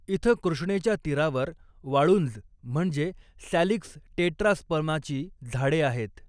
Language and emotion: Marathi, neutral